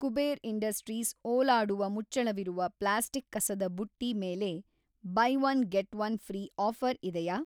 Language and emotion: Kannada, neutral